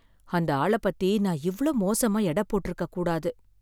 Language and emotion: Tamil, sad